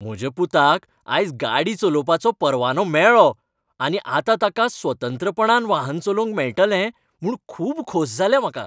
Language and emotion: Goan Konkani, happy